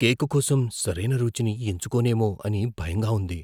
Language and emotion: Telugu, fearful